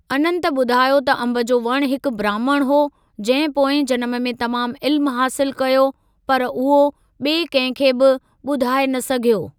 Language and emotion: Sindhi, neutral